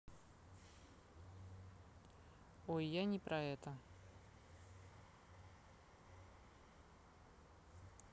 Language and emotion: Russian, neutral